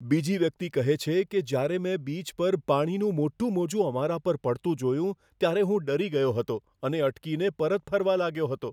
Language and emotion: Gujarati, fearful